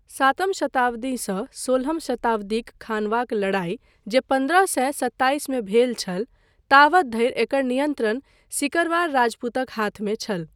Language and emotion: Maithili, neutral